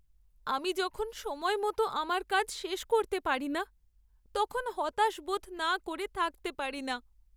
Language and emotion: Bengali, sad